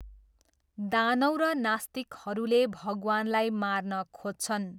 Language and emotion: Nepali, neutral